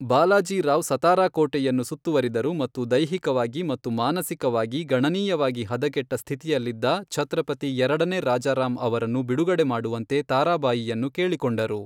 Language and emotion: Kannada, neutral